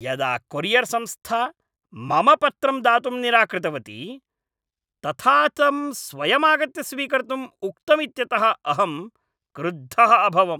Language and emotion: Sanskrit, angry